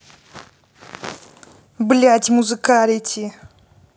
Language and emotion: Russian, angry